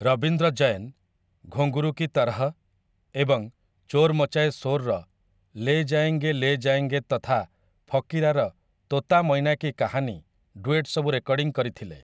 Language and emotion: Odia, neutral